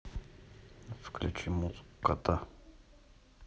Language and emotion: Russian, neutral